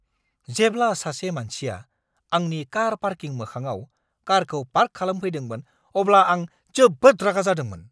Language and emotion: Bodo, angry